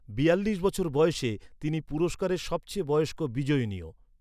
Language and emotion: Bengali, neutral